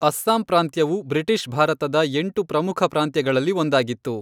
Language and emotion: Kannada, neutral